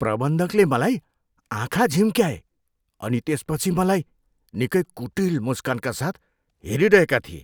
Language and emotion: Nepali, disgusted